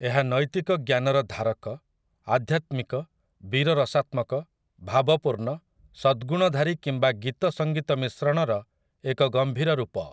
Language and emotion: Odia, neutral